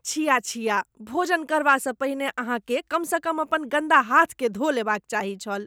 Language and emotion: Maithili, disgusted